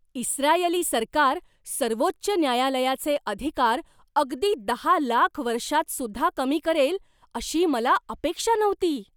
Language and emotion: Marathi, surprised